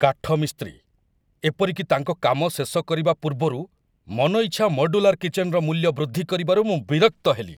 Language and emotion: Odia, angry